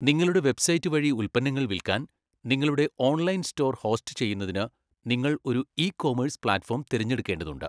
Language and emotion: Malayalam, neutral